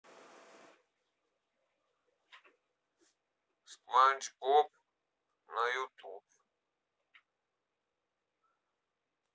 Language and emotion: Russian, neutral